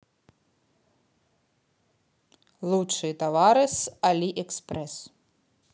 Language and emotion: Russian, neutral